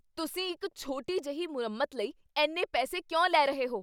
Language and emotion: Punjabi, angry